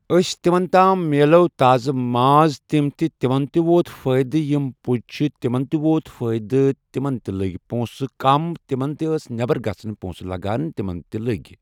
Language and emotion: Kashmiri, neutral